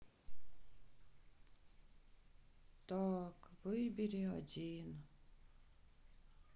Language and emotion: Russian, sad